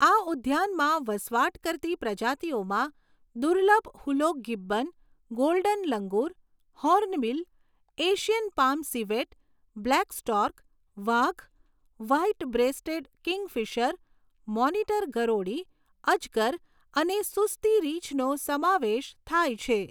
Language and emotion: Gujarati, neutral